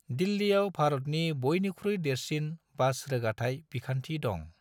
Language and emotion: Bodo, neutral